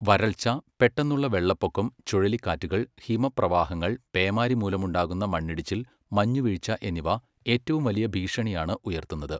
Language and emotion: Malayalam, neutral